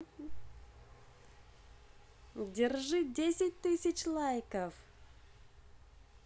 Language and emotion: Russian, positive